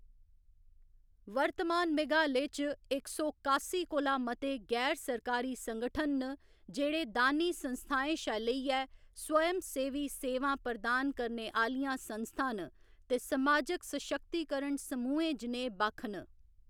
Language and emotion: Dogri, neutral